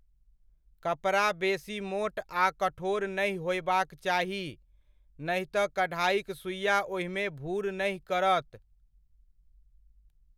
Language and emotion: Maithili, neutral